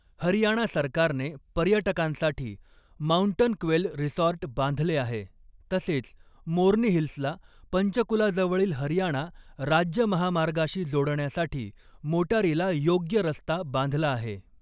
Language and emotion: Marathi, neutral